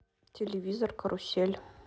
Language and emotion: Russian, neutral